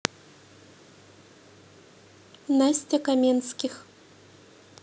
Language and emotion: Russian, neutral